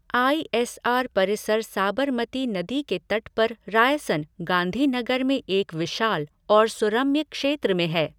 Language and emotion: Hindi, neutral